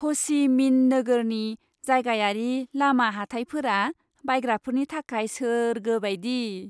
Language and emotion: Bodo, happy